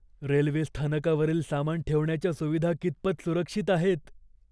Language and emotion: Marathi, fearful